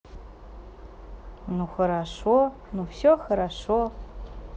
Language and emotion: Russian, positive